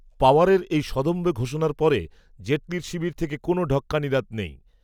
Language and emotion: Bengali, neutral